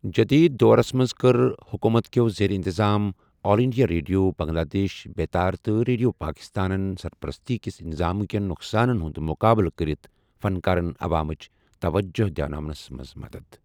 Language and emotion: Kashmiri, neutral